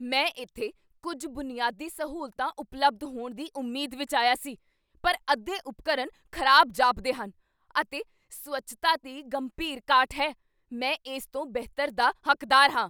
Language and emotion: Punjabi, angry